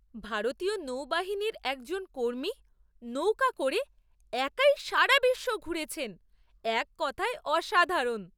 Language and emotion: Bengali, surprised